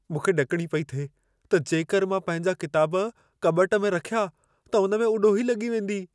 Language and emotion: Sindhi, fearful